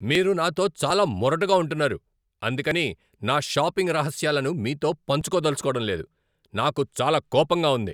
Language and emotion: Telugu, angry